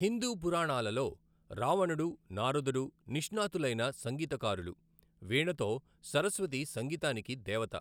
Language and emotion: Telugu, neutral